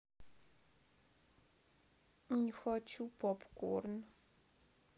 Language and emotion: Russian, sad